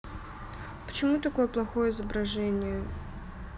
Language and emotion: Russian, sad